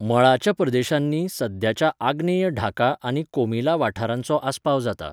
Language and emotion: Goan Konkani, neutral